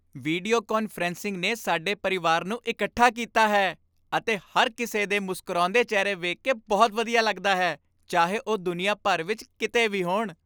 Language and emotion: Punjabi, happy